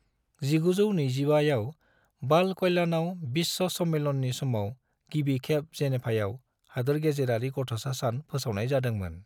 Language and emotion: Bodo, neutral